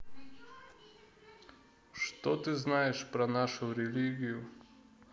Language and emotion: Russian, neutral